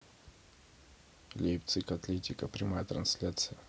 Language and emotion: Russian, neutral